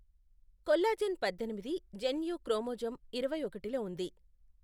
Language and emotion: Telugu, neutral